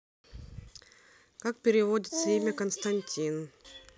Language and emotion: Russian, neutral